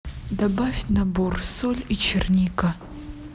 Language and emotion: Russian, neutral